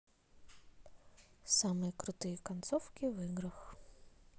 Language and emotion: Russian, neutral